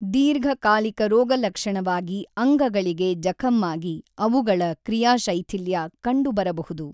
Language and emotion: Kannada, neutral